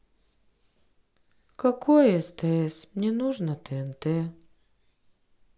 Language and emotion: Russian, sad